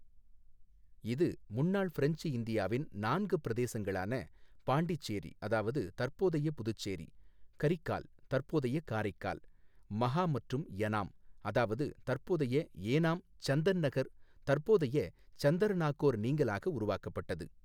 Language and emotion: Tamil, neutral